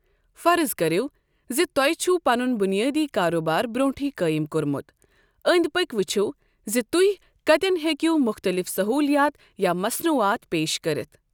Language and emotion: Kashmiri, neutral